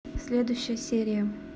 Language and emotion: Russian, neutral